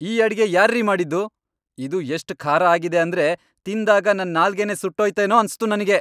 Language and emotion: Kannada, angry